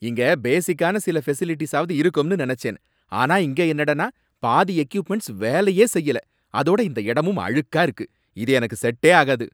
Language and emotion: Tamil, angry